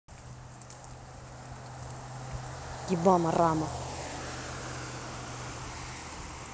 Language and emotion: Russian, angry